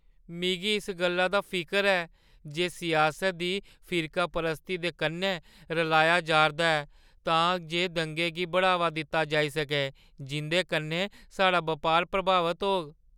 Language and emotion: Dogri, fearful